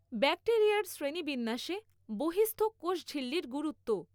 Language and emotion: Bengali, neutral